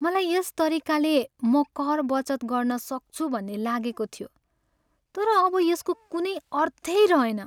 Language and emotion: Nepali, sad